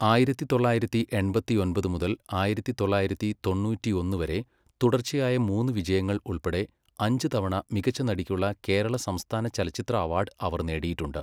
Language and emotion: Malayalam, neutral